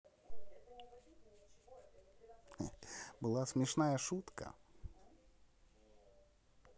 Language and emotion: Russian, positive